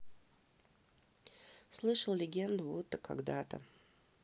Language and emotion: Russian, neutral